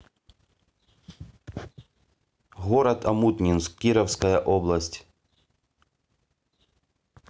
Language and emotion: Russian, neutral